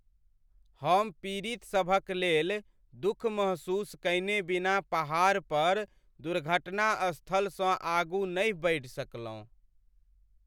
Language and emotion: Maithili, sad